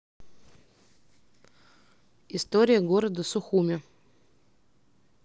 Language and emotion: Russian, neutral